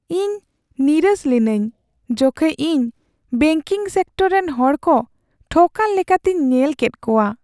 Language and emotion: Santali, sad